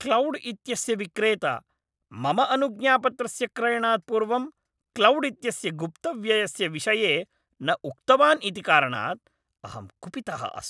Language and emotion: Sanskrit, angry